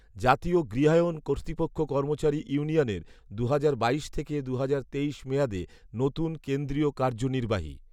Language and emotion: Bengali, neutral